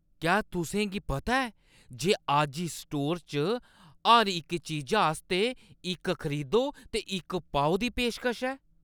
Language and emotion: Dogri, surprised